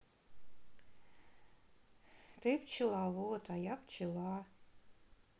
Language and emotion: Russian, sad